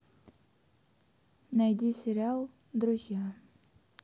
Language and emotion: Russian, neutral